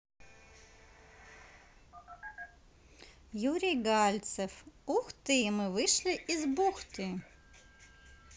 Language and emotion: Russian, neutral